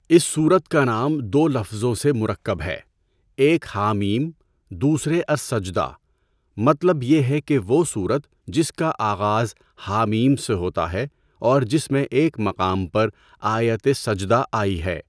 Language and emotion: Urdu, neutral